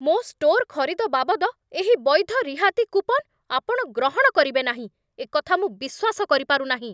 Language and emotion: Odia, angry